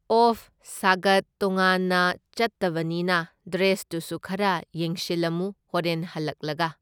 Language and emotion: Manipuri, neutral